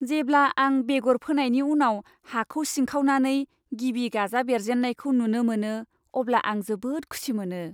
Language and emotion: Bodo, happy